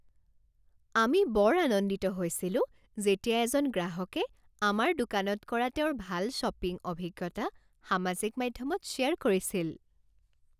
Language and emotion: Assamese, happy